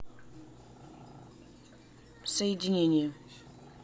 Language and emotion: Russian, neutral